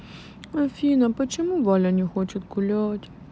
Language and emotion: Russian, sad